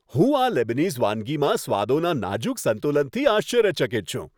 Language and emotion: Gujarati, happy